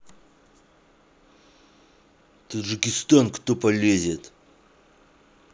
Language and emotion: Russian, angry